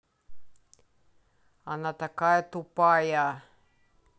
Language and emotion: Russian, angry